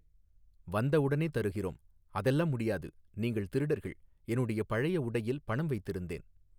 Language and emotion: Tamil, neutral